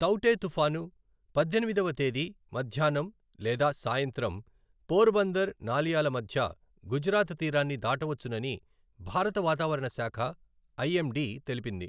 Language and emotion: Telugu, neutral